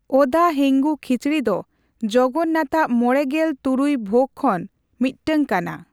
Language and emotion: Santali, neutral